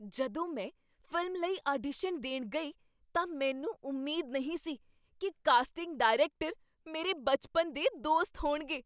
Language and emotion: Punjabi, surprised